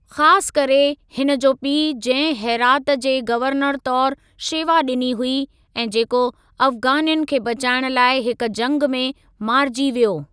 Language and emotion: Sindhi, neutral